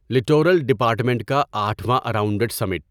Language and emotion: Urdu, neutral